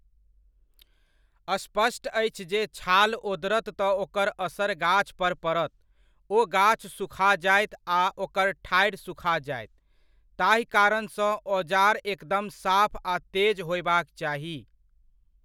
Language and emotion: Maithili, neutral